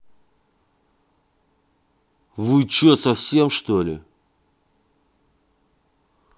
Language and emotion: Russian, angry